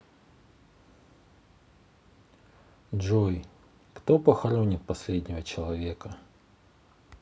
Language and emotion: Russian, sad